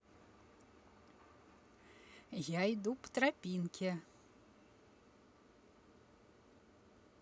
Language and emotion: Russian, positive